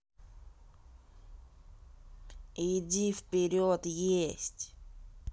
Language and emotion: Russian, angry